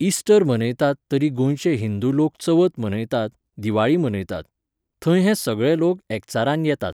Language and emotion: Goan Konkani, neutral